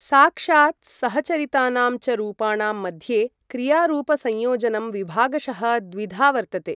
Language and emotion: Sanskrit, neutral